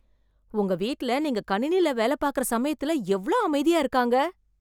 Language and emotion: Tamil, surprised